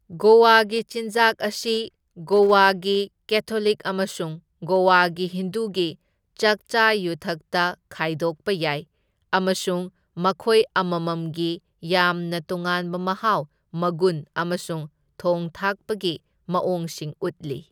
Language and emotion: Manipuri, neutral